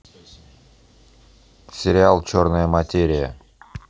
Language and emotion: Russian, neutral